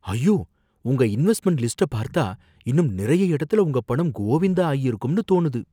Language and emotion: Tamil, fearful